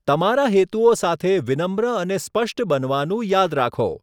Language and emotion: Gujarati, neutral